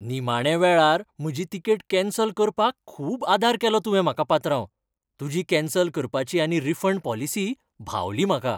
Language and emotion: Goan Konkani, happy